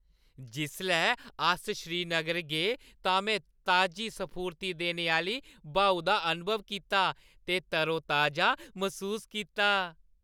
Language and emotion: Dogri, happy